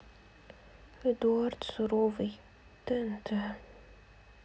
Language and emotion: Russian, sad